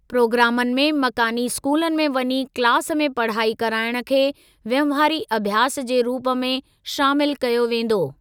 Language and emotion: Sindhi, neutral